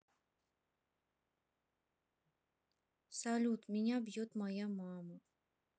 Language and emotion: Russian, sad